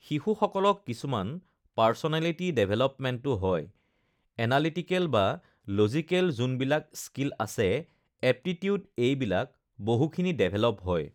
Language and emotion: Assamese, neutral